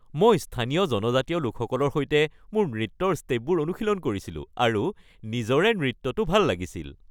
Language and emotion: Assamese, happy